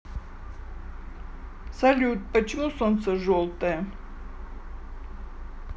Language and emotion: Russian, neutral